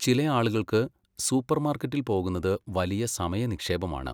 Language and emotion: Malayalam, neutral